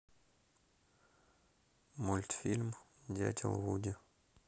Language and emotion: Russian, neutral